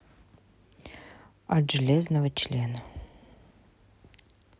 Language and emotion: Russian, neutral